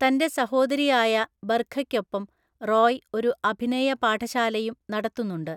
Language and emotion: Malayalam, neutral